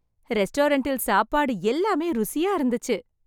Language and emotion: Tamil, happy